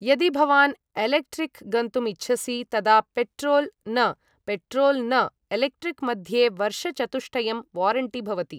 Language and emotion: Sanskrit, neutral